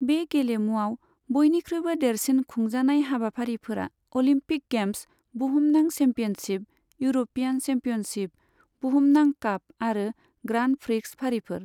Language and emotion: Bodo, neutral